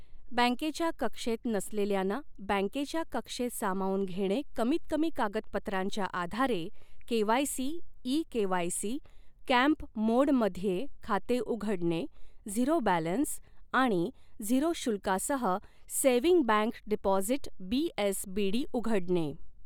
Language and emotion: Marathi, neutral